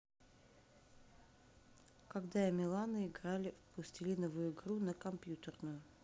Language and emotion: Russian, neutral